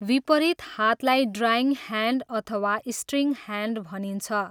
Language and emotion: Nepali, neutral